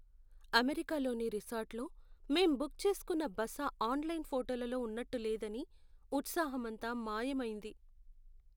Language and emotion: Telugu, sad